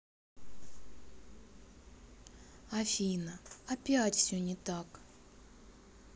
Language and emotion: Russian, sad